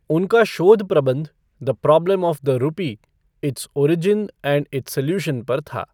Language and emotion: Hindi, neutral